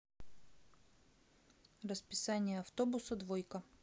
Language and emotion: Russian, neutral